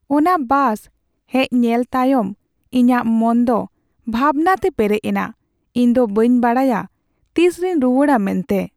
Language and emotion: Santali, sad